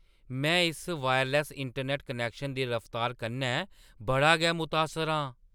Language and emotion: Dogri, surprised